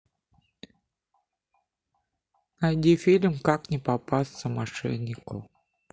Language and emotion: Russian, neutral